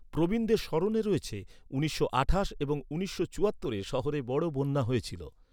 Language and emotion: Bengali, neutral